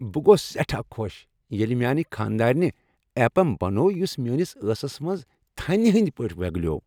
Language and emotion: Kashmiri, happy